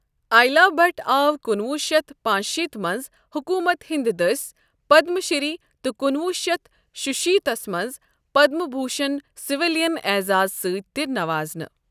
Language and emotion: Kashmiri, neutral